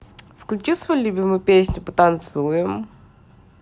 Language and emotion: Russian, positive